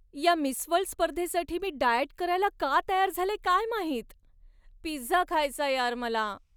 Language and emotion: Marathi, sad